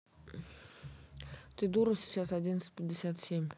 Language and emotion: Russian, neutral